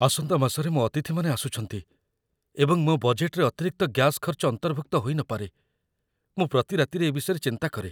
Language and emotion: Odia, fearful